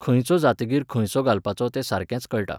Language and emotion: Goan Konkani, neutral